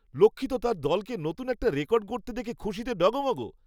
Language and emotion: Bengali, happy